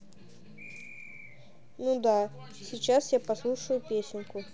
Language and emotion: Russian, neutral